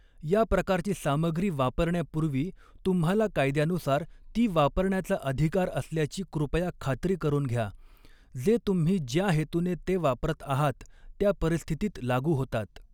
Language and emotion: Marathi, neutral